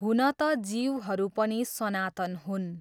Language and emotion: Nepali, neutral